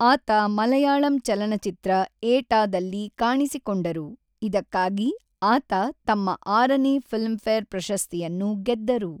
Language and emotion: Kannada, neutral